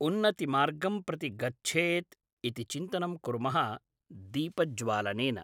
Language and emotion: Sanskrit, neutral